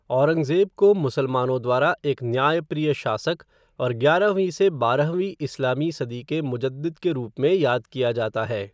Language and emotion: Hindi, neutral